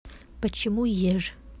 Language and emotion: Russian, neutral